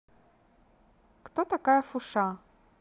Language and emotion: Russian, neutral